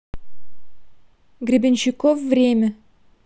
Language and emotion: Russian, neutral